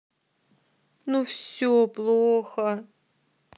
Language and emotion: Russian, sad